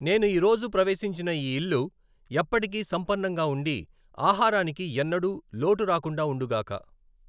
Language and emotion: Telugu, neutral